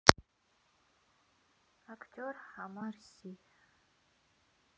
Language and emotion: Russian, sad